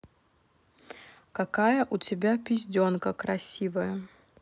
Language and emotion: Russian, neutral